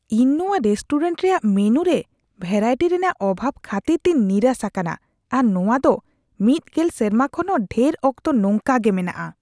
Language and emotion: Santali, disgusted